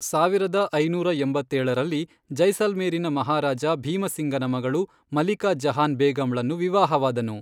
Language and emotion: Kannada, neutral